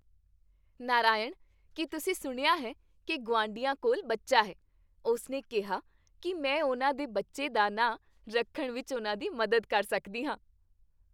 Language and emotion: Punjabi, happy